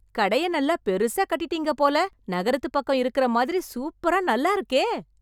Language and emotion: Tamil, happy